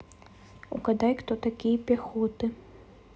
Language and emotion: Russian, neutral